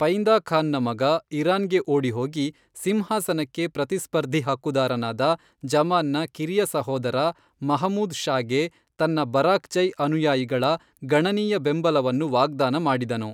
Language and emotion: Kannada, neutral